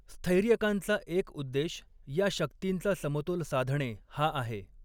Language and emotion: Marathi, neutral